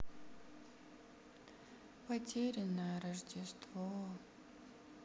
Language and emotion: Russian, sad